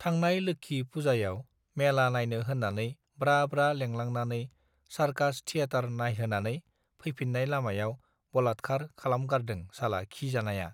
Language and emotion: Bodo, neutral